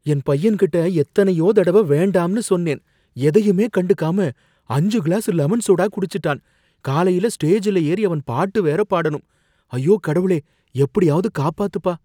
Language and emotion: Tamil, fearful